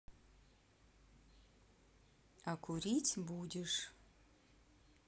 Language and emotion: Russian, neutral